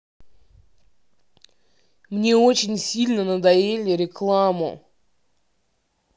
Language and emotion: Russian, angry